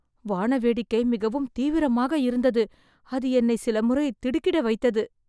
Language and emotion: Tamil, fearful